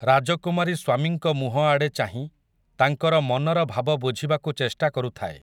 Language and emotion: Odia, neutral